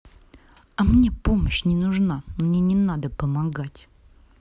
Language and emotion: Russian, angry